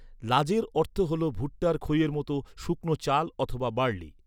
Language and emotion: Bengali, neutral